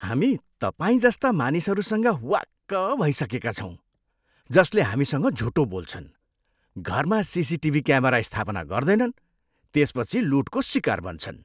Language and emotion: Nepali, disgusted